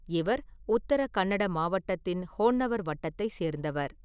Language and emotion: Tamil, neutral